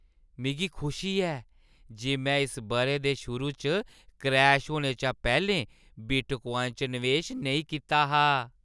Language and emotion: Dogri, happy